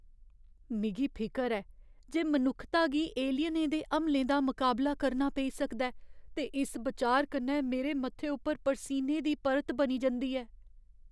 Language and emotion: Dogri, fearful